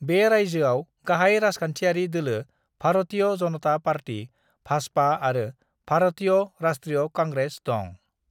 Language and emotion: Bodo, neutral